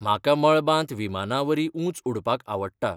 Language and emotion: Goan Konkani, neutral